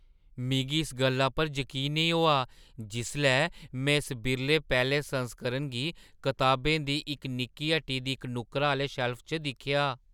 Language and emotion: Dogri, surprised